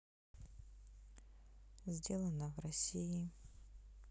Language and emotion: Russian, sad